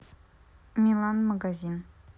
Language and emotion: Russian, neutral